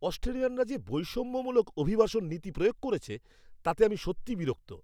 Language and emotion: Bengali, angry